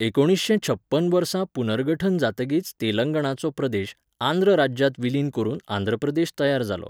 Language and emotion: Goan Konkani, neutral